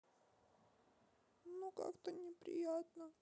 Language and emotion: Russian, sad